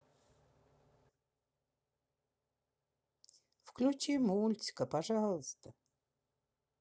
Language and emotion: Russian, sad